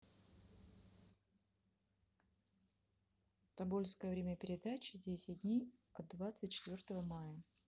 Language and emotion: Russian, neutral